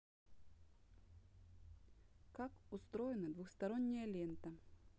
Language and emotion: Russian, neutral